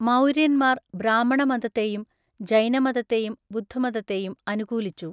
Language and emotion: Malayalam, neutral